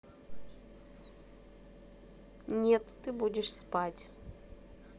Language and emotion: Russian, neutral